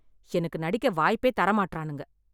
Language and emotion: Tamil, angry